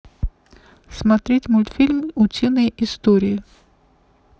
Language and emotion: Russian, neutral